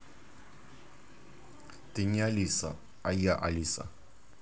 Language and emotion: Russian, neutral